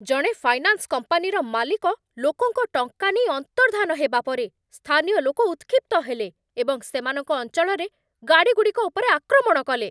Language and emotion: Odia, angry